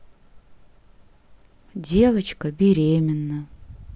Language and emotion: Russian, sad